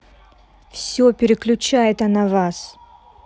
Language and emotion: Russian, angry